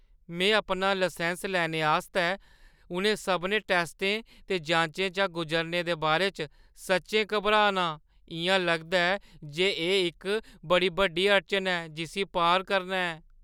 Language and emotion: Dogri, fearful